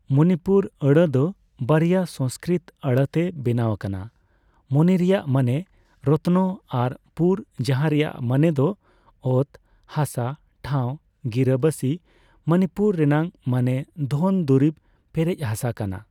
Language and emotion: Santali, neutral